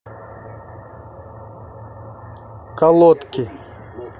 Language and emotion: Russian, neutral